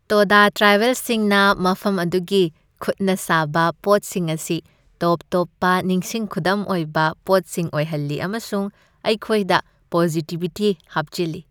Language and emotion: Manipuri, happy